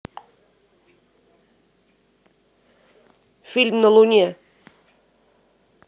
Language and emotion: Russian, neutral